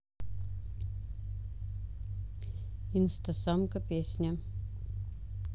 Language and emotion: Russian, neutral